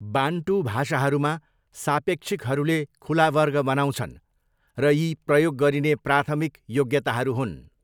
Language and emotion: Nepali, neutral